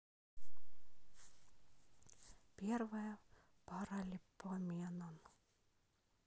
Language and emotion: Russian, sad